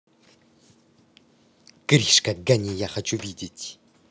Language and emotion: Russian, angry